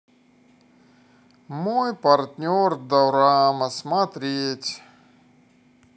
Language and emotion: Russian, neutral